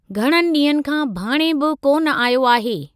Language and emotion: Sindhi, neutral